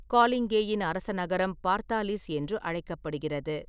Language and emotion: Tamil, neutral